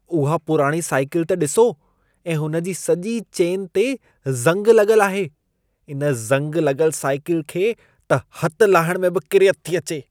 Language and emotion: Sindhi, disgusted